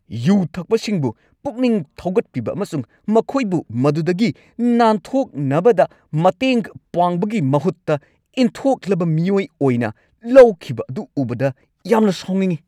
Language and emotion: Manipuri, angry